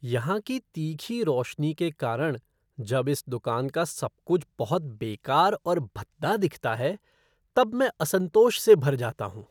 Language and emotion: Hindi, disgusted